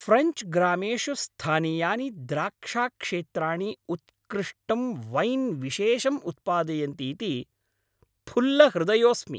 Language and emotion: Sanskrit, happy